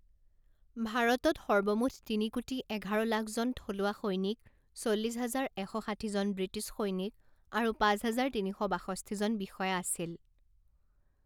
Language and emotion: Assamese, neutral